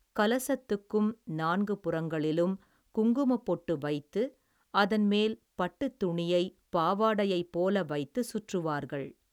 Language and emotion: Tamil, neutral